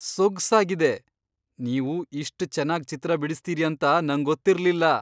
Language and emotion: Kannada, surprised